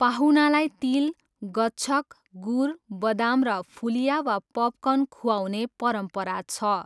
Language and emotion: Nepali, neutral